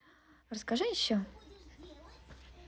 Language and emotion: Russian, positive